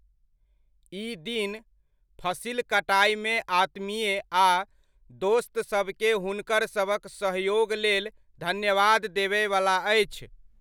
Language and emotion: Maithili, neutral